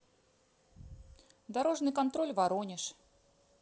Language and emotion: Russian, neutral